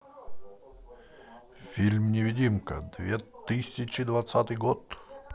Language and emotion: Russian, positive